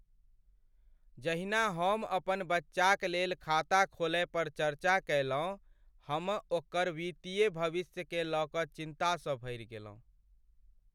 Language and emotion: Maithili, sad